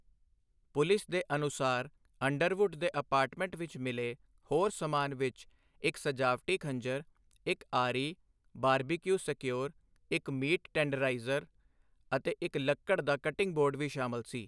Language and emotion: Punjabi, neutral